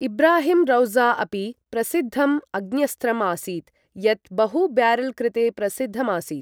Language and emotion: Sanskrit, neutral